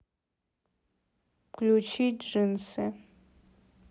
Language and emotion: Russian, neutral